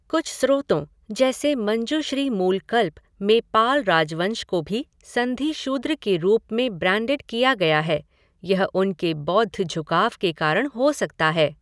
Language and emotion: Hindi, neutral